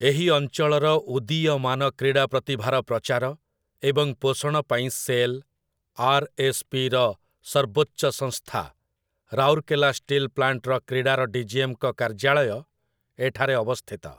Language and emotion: Odia, neutral